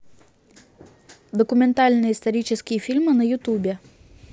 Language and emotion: Russian, neutral